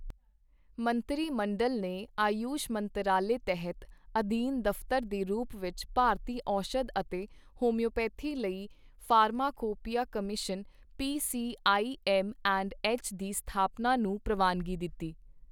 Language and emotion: Punjabi, neutral